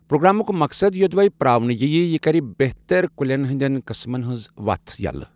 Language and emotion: Kashmiri, neutral